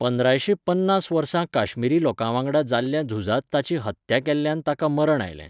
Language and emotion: Goan Konkani, neutral